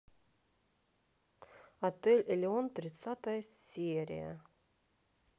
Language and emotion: Russian, neutral